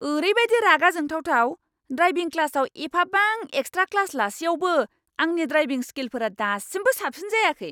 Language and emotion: Bodo, angry